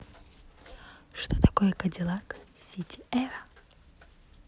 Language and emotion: Russian, neutral